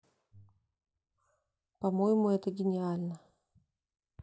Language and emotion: Russian, neutral